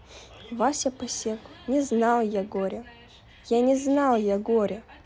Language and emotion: Russian, neutral